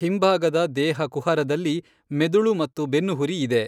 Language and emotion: Kannada, neutral